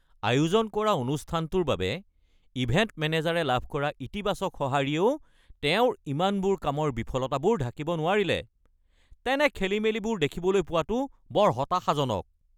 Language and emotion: Assamese, angry